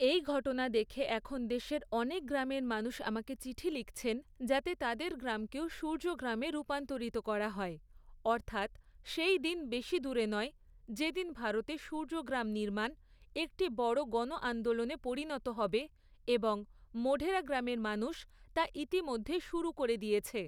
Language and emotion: Bengali, neutral